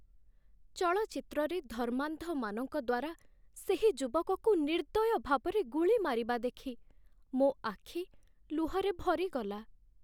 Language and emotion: Odia, sad